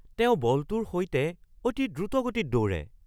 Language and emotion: Assamese, surprised